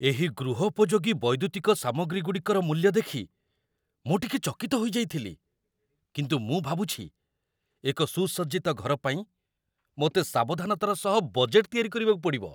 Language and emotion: Odia, surprised